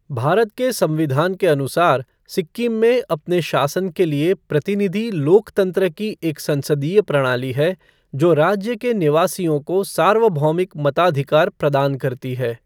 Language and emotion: Hindi, neutral